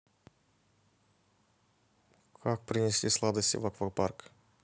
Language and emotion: Russian, neutral